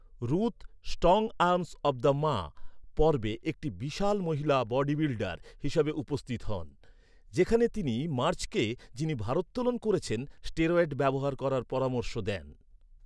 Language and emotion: Bengali, neutral